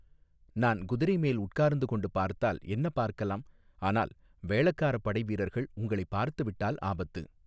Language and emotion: Tamil, neutral